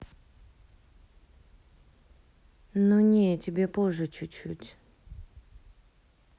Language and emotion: Russian, neutral